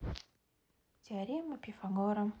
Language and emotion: Russian, neutral